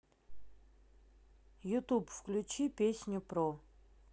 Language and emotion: Russian, neutral